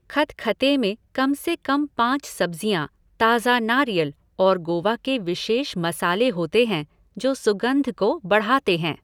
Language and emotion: Hindi, neutral